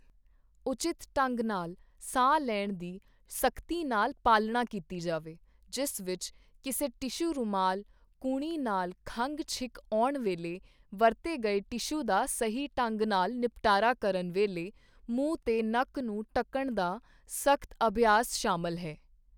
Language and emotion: Punjabi, neutral